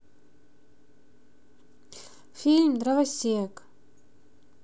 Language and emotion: Russian, neutral